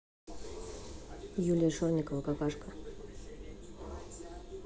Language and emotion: Russian, neutral